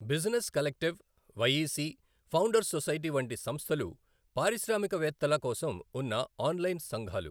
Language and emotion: Telugu, neutral